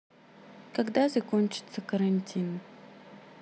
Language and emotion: Russian, neutral